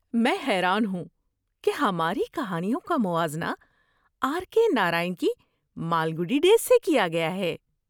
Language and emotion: Urdu, surprised